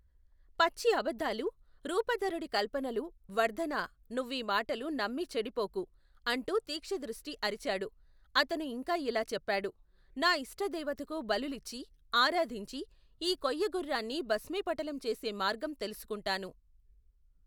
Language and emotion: Telugu, neutral